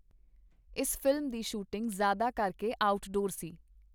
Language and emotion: Punjabi, neutral